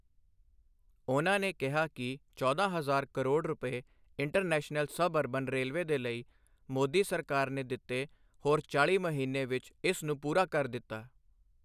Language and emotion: Punjabi, neutral